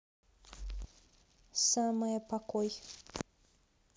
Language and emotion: Russian, neutral